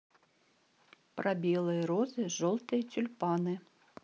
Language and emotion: Russian, neutral